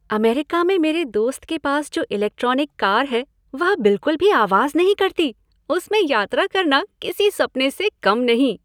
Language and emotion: Hindi, happy